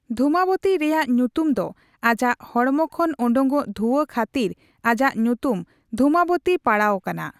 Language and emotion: Santali, neutral